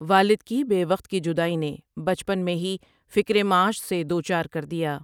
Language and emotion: Urdu, neutral